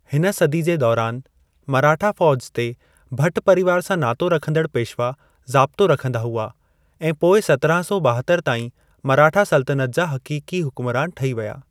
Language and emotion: Sindhi, neutral